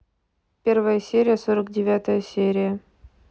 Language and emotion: Russian, neutral